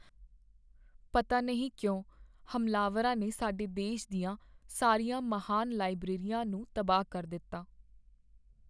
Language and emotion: Punjabi, sad